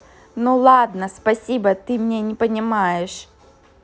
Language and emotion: Russian, neutral